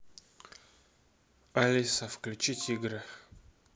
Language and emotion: Russian, neutral